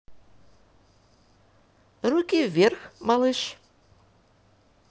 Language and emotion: Russian, positive